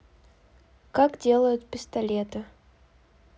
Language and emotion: Russian, neutral